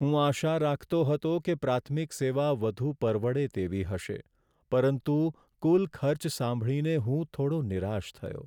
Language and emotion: Gujarati, sad